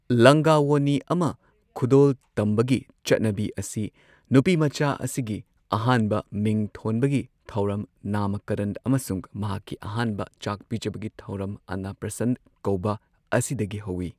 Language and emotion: Manipuri, neutral